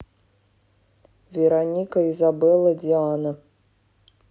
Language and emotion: Russian, neutral